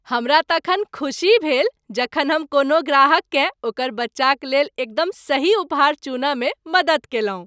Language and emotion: Maithili, happy